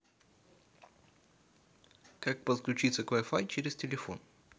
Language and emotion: Russian, neutral